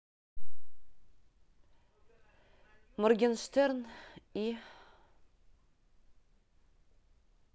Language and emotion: Russian, neutral